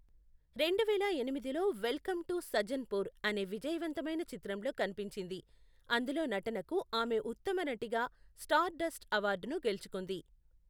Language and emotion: Telugu, neutral